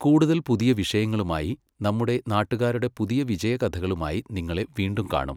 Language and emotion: Malayalam, neutral